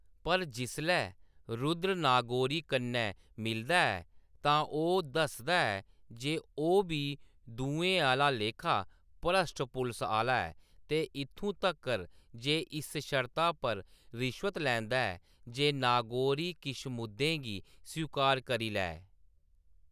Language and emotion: Dogri, neutral